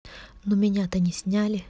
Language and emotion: Russian, neutral